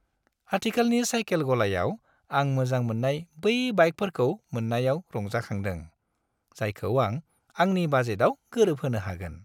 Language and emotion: Bodo, happy